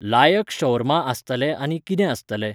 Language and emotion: Goan Konkani, neutral